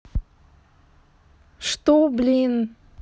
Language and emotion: Russian, angry